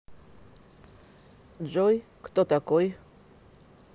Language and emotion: Russian, neutral